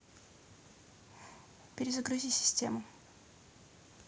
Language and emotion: Russian, neutral